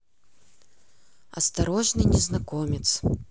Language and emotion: Russian, neutral